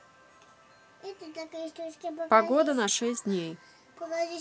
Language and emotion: Russian, neutral